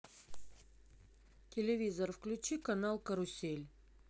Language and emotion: Russian, neutral